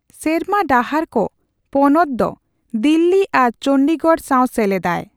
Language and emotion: Santali, neutral